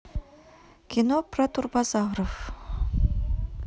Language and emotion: Russian, neutral